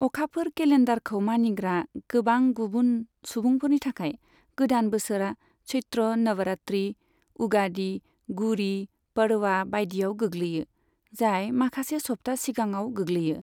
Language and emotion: Bodo, neutral